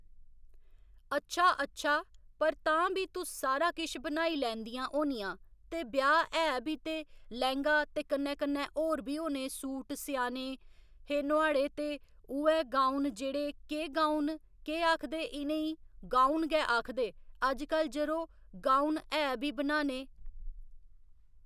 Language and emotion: Dogri, neutral